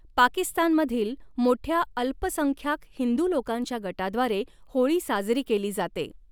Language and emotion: Marathi, neutral